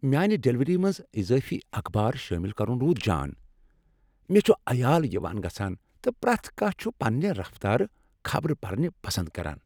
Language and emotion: Kashmiri, happy